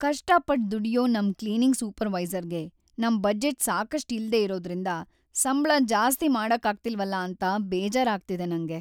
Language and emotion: Kannada, sad